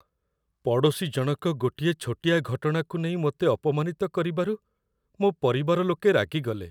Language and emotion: Odia, sad